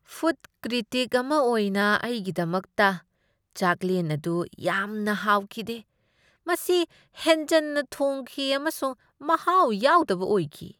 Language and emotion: Manipuri, disgusted